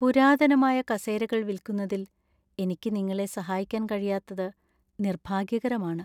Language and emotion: Malayalam, sad